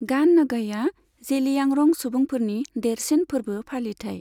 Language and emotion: Bodo, neutral